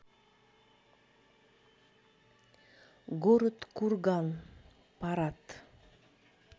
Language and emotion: Russian, neutral